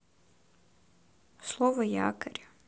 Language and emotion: Russian, neutral